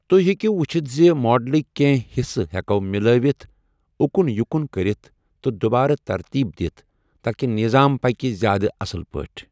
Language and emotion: Kashmiri, neutral